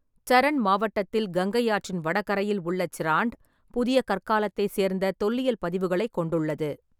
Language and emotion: Tamil, neutral